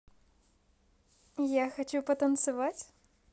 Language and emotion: Russian, positive